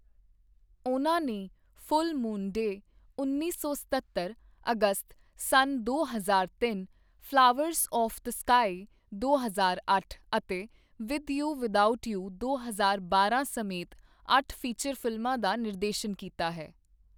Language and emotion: Punjabi, neutral